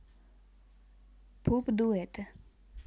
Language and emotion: Russian, neutral